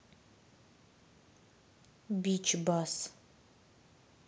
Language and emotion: Russian, neutral